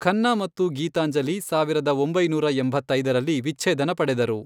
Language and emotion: Kannada, neutral